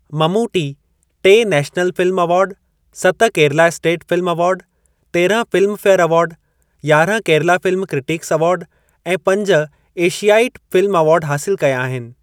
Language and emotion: Sindhi, neutral